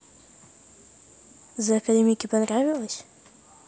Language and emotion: Russian, neutral